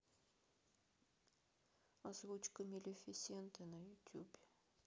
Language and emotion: Russian, sad